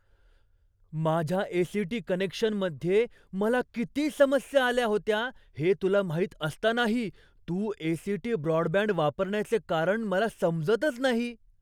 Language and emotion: Marathi, surprised